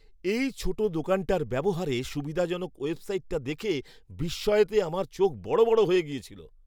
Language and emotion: Bengali, surprised